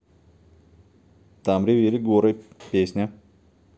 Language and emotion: Russian, neutral